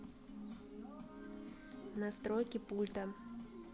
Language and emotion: Russian, neutral